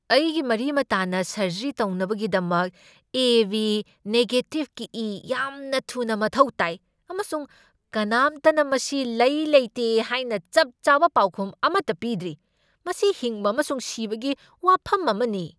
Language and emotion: Manipuri, angry